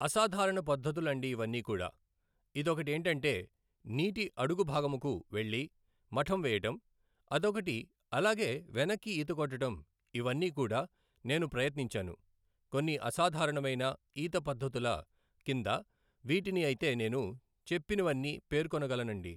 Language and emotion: Telugu, neutral